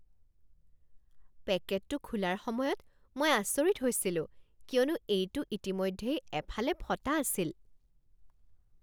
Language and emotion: Assamese, surprised